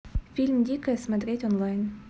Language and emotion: Russian, neutral